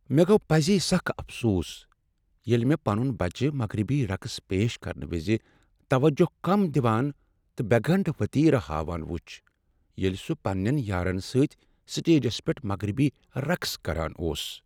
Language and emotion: Kashmiri, sad